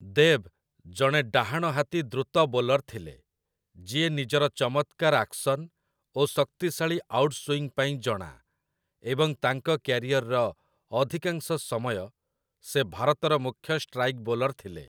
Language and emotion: Odia, neutral